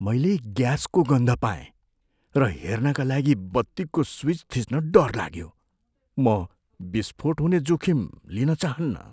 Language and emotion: Nepali, fearful